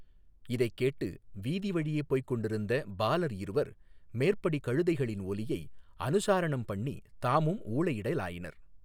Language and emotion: Tamil, neutral